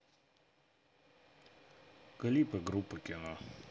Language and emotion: Russian, neutral